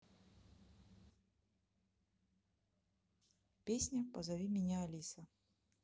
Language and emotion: Russian, neutral